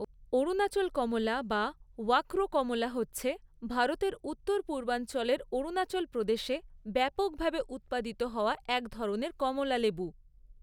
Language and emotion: Bengali, neutral